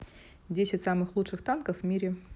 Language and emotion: Russian, neutral